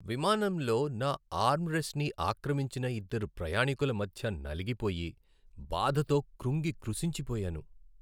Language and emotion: Telugu, sad